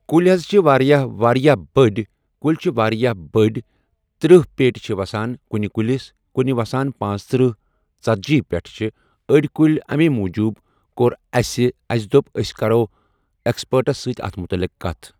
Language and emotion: Kashmiri, neutral